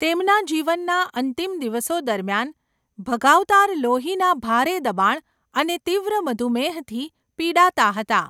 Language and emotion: Gujarati, neutral